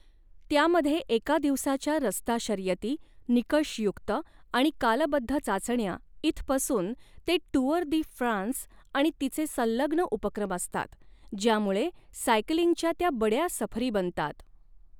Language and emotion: Marathi, neutral